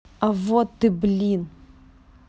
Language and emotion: Russian, neutral